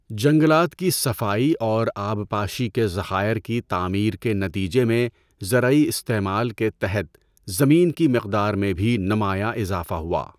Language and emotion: Urdu, neutral